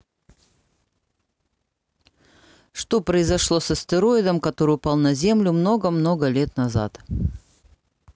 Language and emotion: Russian, neutral